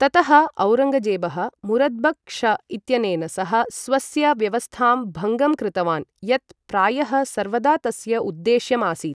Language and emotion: Sanskrit, neutral